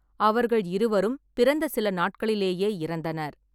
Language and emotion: Tamil, neutral